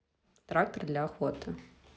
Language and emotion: Russian, neutral